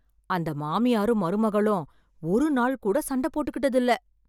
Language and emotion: Tamil, surprised